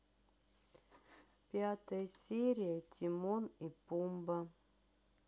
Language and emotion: Russian, sad